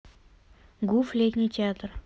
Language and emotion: Russian, neutral